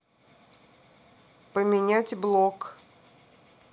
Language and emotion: Russian, neutral